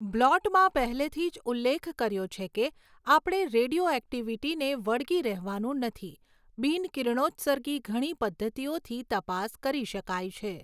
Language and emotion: Gujarati, neutral